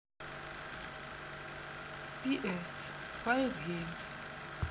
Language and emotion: Russian, neutral